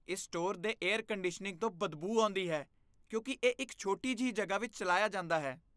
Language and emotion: Punjabi, disgusted